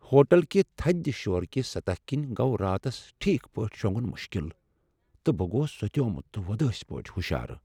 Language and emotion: Kashmiri, sad